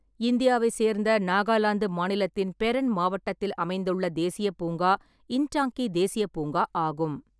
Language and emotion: Tamil, neutral